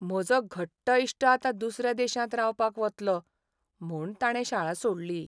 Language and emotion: Goan Konkani, sad